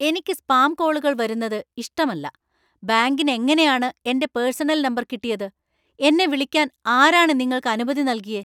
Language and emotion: Malayalam, angry